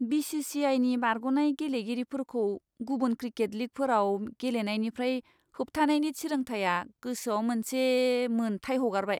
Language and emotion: Bodo, disgusted